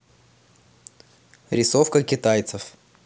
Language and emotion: Russian, neutral